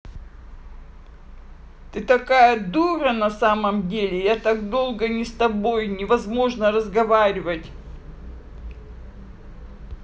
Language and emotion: Russian, angry